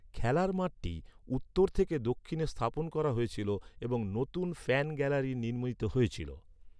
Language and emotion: Bengali, neutral